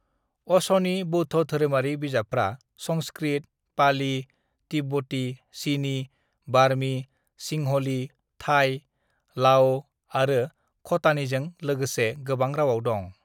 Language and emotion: Bodo, neutral